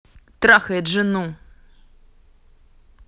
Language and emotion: Russian, angry